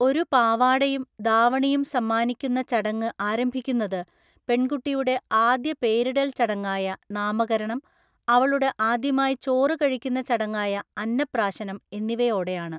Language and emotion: Malayalam, neutral